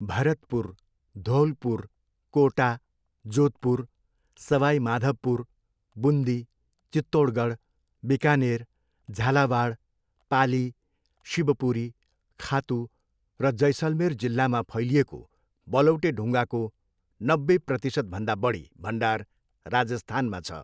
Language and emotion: Nepali, neutral